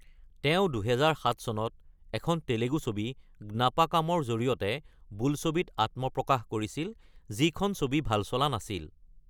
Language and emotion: Assamese, neutral